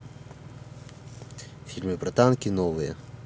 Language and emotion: Russian, neutral